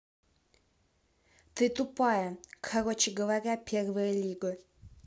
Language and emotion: Russian, angry